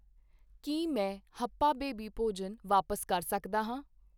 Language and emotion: Punjabi, neutral